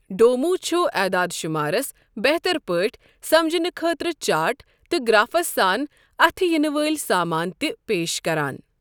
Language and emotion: Kashmiri, neutral